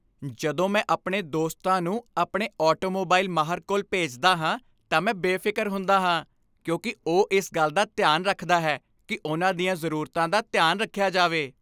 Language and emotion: Punjabi, happy